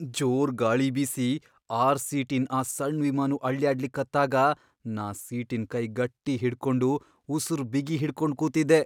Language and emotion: Kannada, fearful